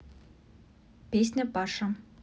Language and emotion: Russian, neutral